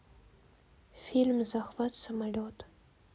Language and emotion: Russian, neutral